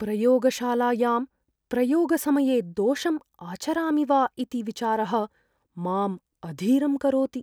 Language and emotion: Sanskrit, fearful